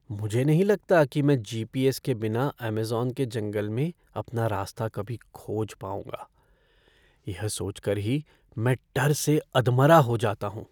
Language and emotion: Hindi, fearful